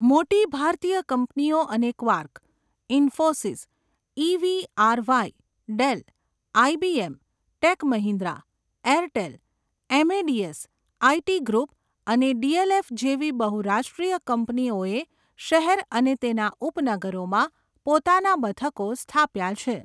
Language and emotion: Gujarati, neutral